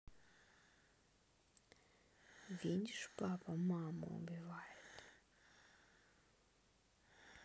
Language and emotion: Russian, sad